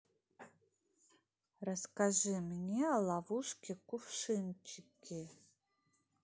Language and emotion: Russian, neutral